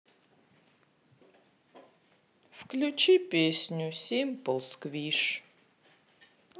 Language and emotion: Russian, sad